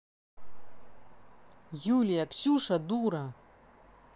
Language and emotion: Russian, angry